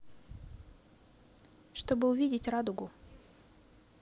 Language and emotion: Russian, neutral